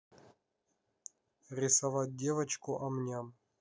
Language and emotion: Russian, neutral